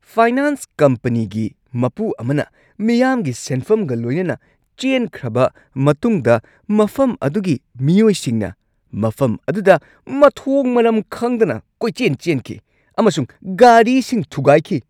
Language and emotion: Manipuri, angry